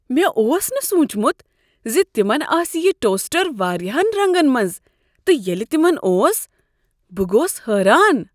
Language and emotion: Kashmiri, surprised